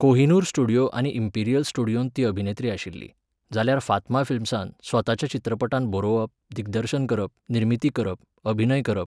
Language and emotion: Goan Konkani, neutral